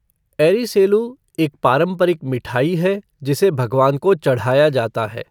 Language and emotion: Hindi, neutral